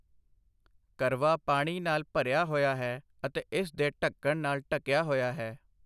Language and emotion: Punjabi, neutral